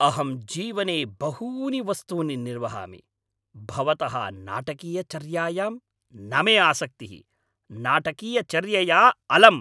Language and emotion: Sanskrit, angry